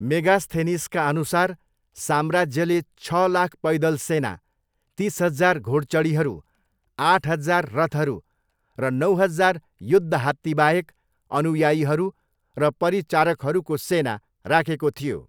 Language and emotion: Nepali, neutral